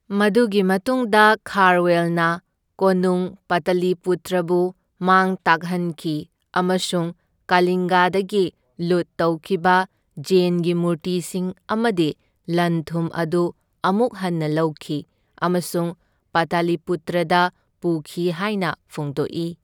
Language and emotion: Manipuri, neutral